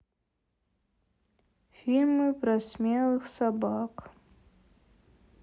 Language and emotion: Russian, sad